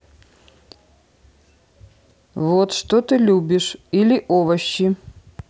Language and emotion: Russian, neutral